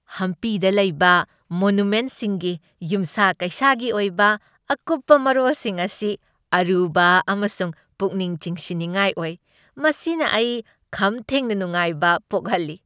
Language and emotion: Manipuri, happy